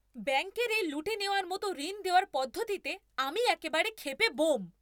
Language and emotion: Bengali, angry